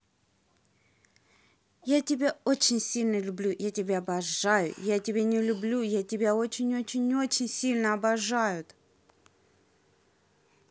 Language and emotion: Russian, positive